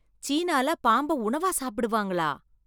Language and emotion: Tamil, surprised